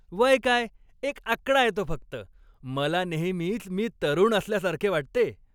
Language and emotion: Marathi, happy